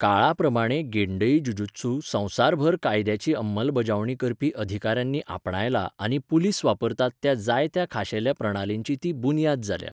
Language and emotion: Goan Konkani, neutral